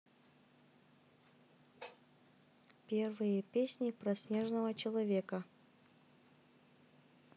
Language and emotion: Russian, neutral